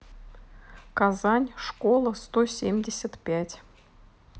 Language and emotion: Russian, neutral